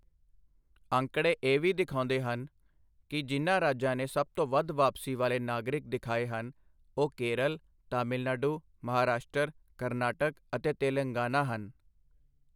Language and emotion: Punjabi, neutral